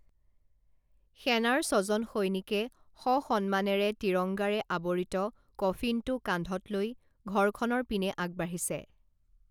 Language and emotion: Assamese, neutral